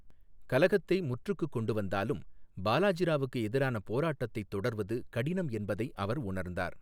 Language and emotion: Tamil, neutral